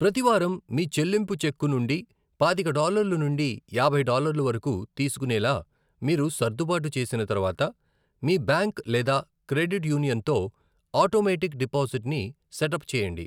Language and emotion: Telugu, neutral